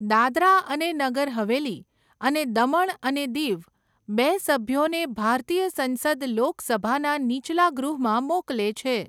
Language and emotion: Gujarati, neutral